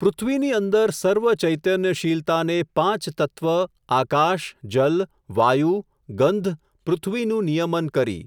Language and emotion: Gujarati, neutral